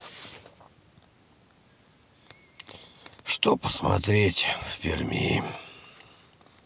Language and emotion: Russian, sad